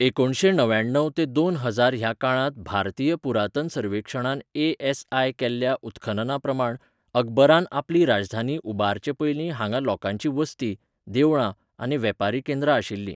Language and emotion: Goan Konkani, neutral